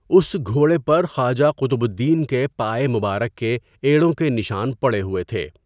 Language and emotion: Urdu, neutral